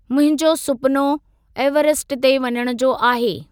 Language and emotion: Sindhi, neutral